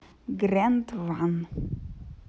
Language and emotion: Russian, neutral